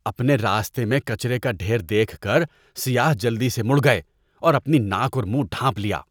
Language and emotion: Urdu, disgusted